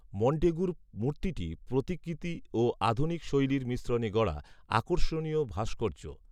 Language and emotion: Bengali, neutral